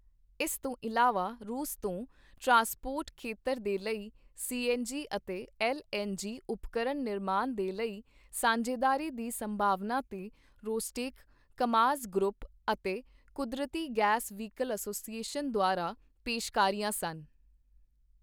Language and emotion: Punjabi, neutral